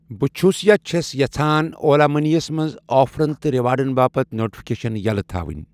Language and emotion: Kashmiri, neutral